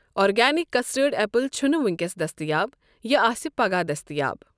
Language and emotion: Kashmiri, neutral